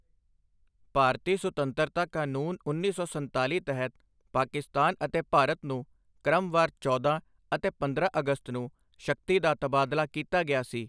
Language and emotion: Punjabi, neutral